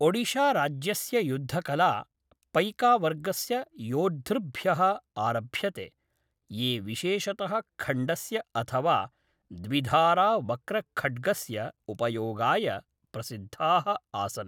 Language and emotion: Sanskrit, neutral